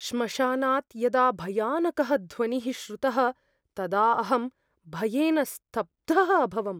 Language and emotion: Sanskrit, fearful